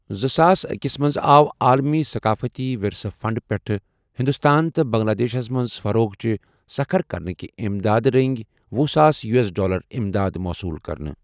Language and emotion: Kashmiri, neutral